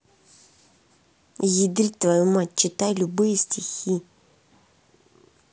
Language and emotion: Russian, angry